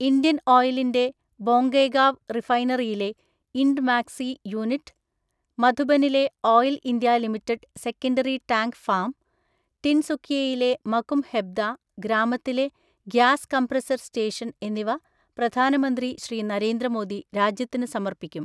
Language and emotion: Malayalam, neutral